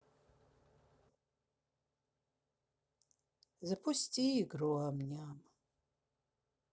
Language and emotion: Russian, sad